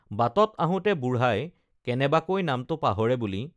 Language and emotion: Assamese, neutral